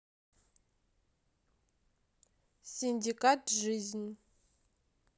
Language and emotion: Russian, neutral